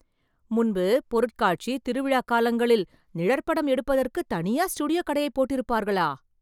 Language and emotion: Tamil, surprised